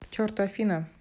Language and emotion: Russian, neutral